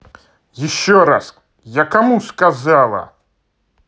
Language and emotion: Russian, angry